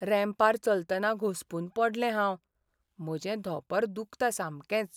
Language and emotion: Goan Konkani, sad